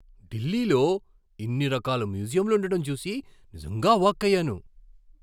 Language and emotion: Telugu, surprised